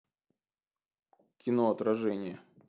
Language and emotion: Russian, neutral